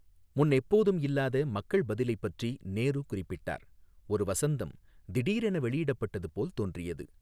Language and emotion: Tamil, neutral